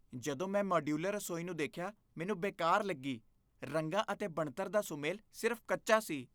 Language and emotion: Punjabi, disgusted